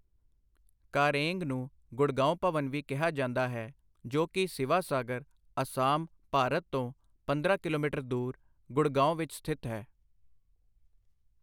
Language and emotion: Punjabi, neutral